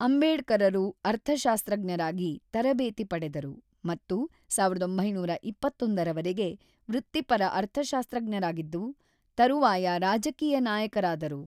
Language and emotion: Kannada, neutral